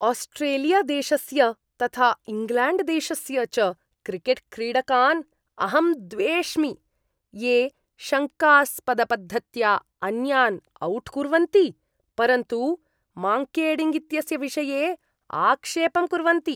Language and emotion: Sanskrit, disgusted